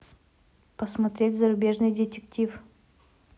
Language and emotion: Russian, neutral